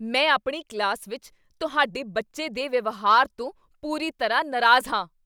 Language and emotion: Punjabi, angry